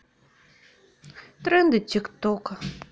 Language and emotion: Russian, sad